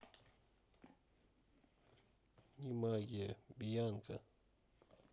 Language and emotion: Russian, neutral